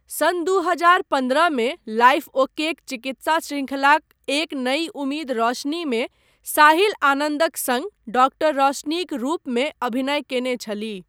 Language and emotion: Maithili, neutral